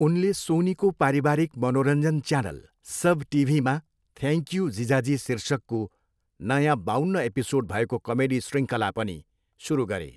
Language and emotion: Nepali, neutral